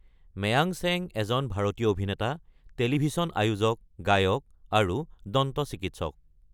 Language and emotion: Assamese, neutral